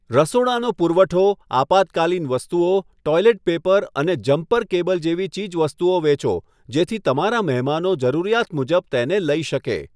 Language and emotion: Gujarati, neutral